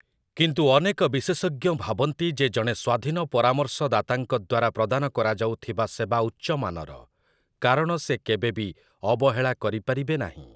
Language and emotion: Odia, neutral